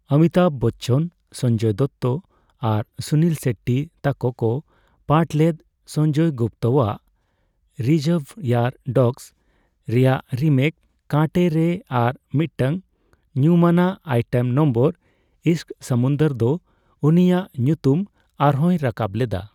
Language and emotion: Santali, neutral